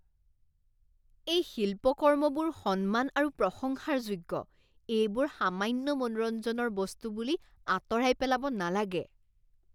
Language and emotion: Assamese, disgusted